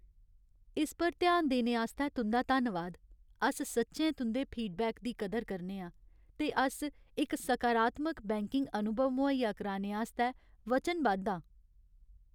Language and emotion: Dogri, sad